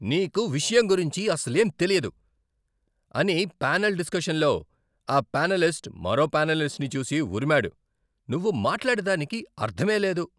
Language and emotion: Telugu, angry